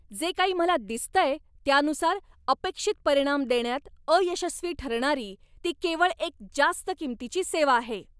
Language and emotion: Marathi, angry